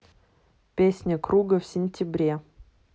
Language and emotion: Russian, neutral